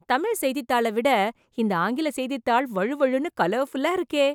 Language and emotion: Tamil, surprised